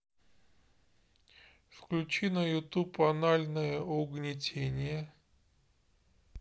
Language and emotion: Russian, neutral